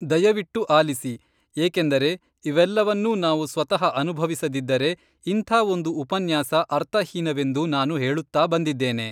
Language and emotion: Kannada, neutral